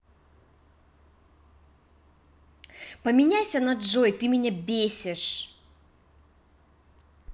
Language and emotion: Russian, angry